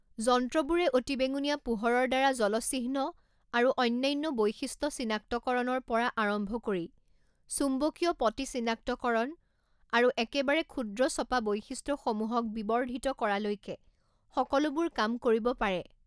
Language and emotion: Assamese, neutral